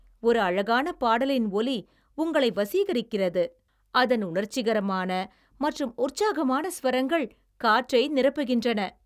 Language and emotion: Tamil, happy